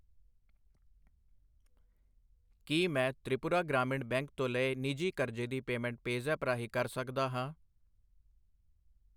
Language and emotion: Punjabi, neutral